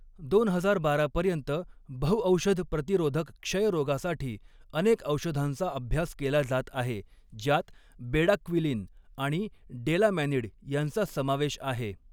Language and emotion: Marathi, neutral